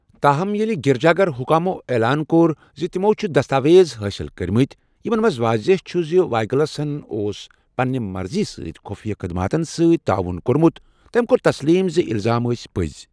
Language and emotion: Kashmiri, neutral